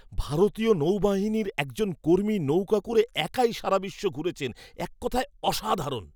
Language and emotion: Bengali, surprised